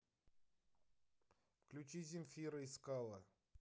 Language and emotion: Russian, neutral